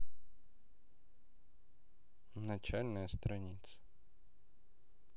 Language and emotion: Russian, neutral